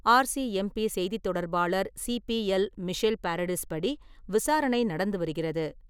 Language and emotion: Tamil, neutral